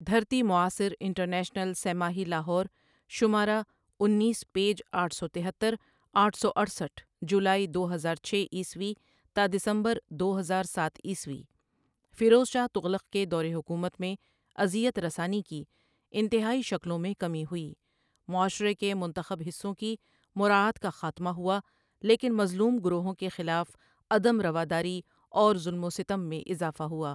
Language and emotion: Urdu, neutral